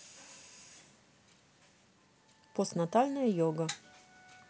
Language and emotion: Russian, neutral